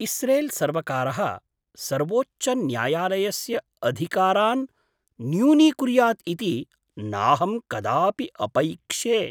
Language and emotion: Sanskrit, surprised